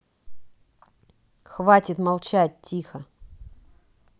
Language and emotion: Russian, angry